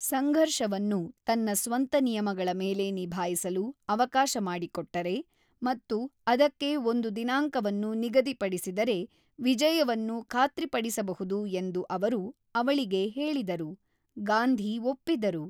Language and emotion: Kannada, neutral